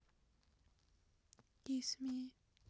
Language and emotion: Russian, sad